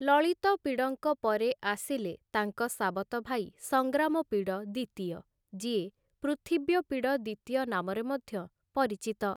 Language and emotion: Odia, neutral